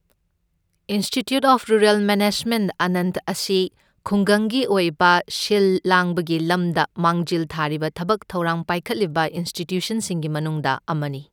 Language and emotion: Manipuri, neutral